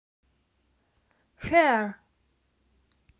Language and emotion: Russian, neutral